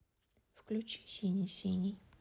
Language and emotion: Russian, sad